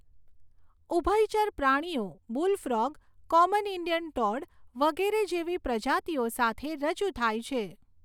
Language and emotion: Gujarati, neutral